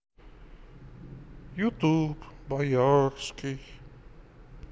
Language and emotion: Russian, sad